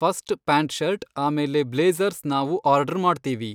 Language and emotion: Kannada, neutral